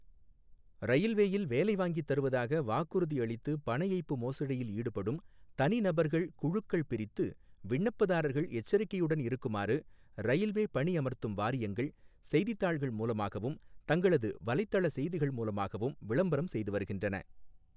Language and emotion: Tamil, neutral